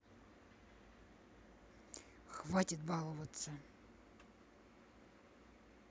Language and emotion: Russian, angry